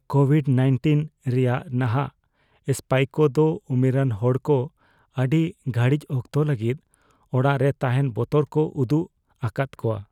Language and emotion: Santali, fearful